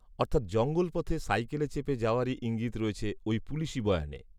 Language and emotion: Bengali, neutral